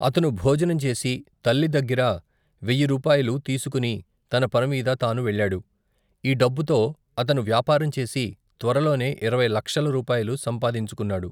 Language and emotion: Telugu, neutral